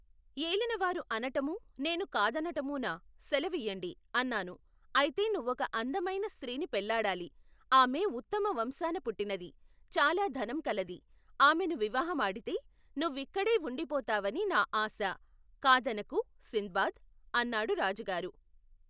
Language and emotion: Telugu, neutral